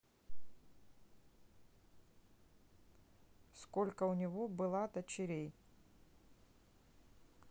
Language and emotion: Russian, neutral